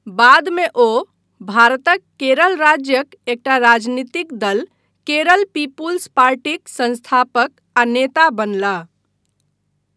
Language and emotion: Maithili, neutral